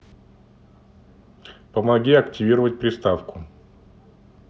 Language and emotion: Russian, neutral